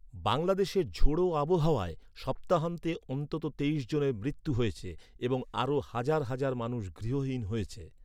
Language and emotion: Bengali, neutral